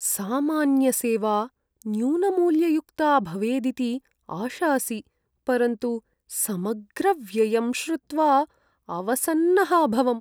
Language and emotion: Sanskrit, sad